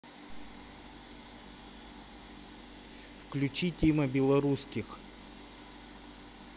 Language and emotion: Russian, neutral